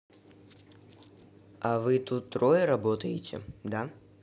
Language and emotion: Russian, neutral